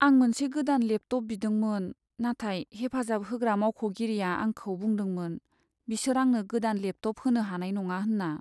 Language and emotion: Bodo, sad